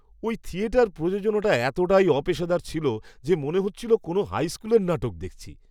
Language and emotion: Bengali, disgusted